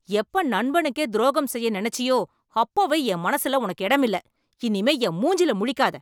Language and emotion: Tamil, angry